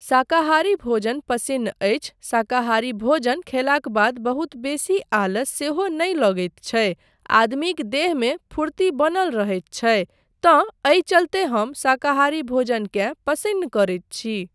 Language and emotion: Maithili, neutral